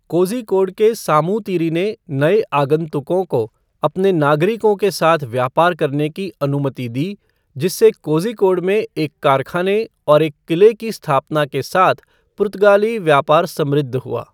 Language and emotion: Hindi, neutral